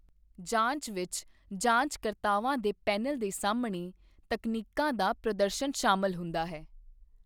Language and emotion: Punjabi, neutral